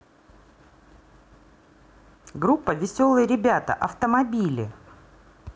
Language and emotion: Russian, positive